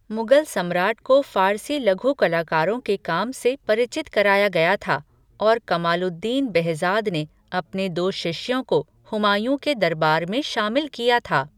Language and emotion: Hindi, neutral